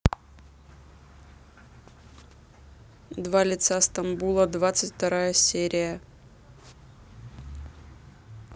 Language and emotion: Russian, neutral